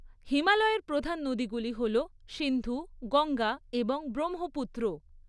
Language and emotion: Bengali, neutral